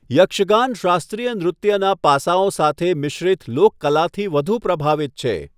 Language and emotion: Gujarati, neutral